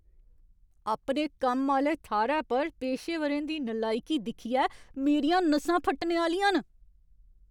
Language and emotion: Dogri, angry